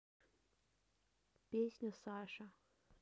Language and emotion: Russian, neutral